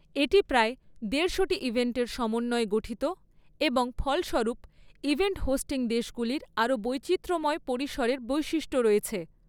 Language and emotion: Bengali, neutral